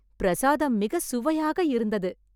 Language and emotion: Tamil, happy